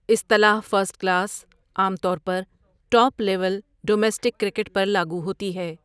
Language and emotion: Urdu, neutral